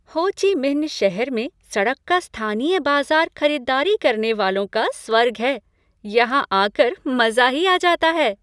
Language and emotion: Hindi, happy